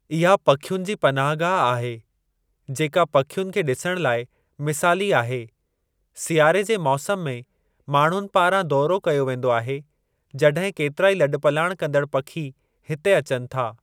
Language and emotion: Sindhi, neutral